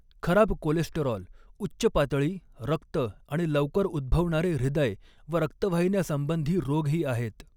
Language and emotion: Marathi, neutral